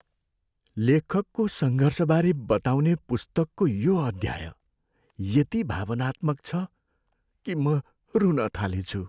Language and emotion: Nepali, sad